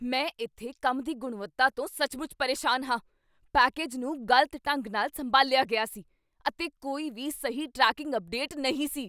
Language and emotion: Punjabi, angry